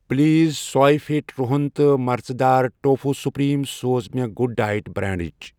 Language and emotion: Kashmiri, neutral